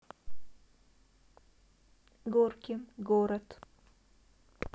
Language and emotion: Russian, neutral